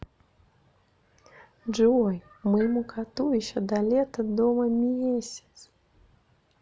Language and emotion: Russian, neutral